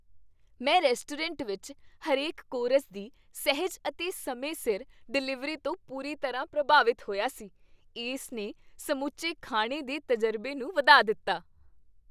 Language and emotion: Punjabi, happy